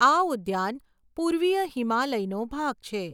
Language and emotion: Gujarati, neutral